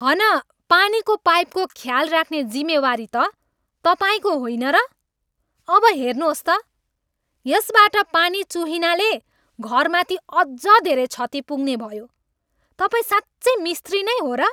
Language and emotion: Nepali, angry